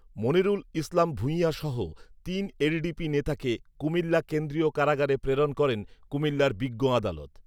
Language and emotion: Bengali, neutral